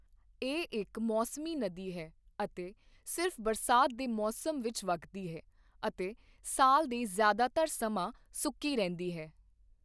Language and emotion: Punjabi, neutral